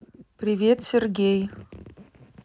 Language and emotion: Russian, neutral